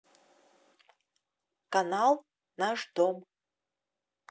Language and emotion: Russian, neutral